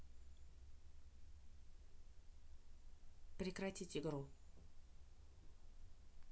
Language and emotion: Russian, neutral